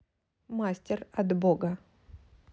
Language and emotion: Russian, neutral